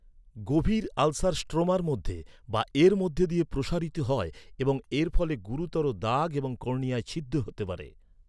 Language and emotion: Bengali, neutral